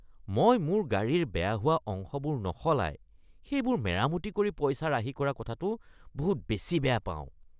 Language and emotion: Assamese, disgusted